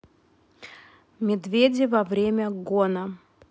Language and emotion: Russian, neutral